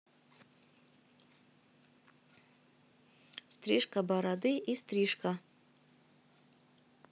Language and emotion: Russian, neutral